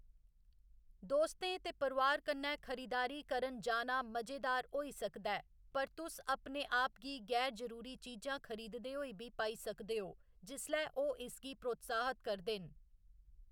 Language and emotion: Dogri, neutral